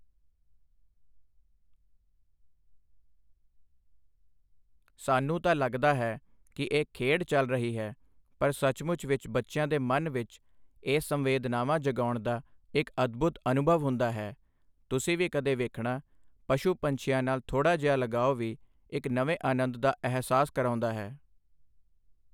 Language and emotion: Punjabi, neutral